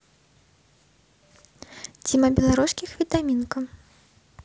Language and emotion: Russian, neutral